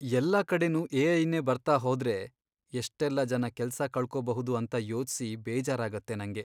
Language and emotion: Kannada, sad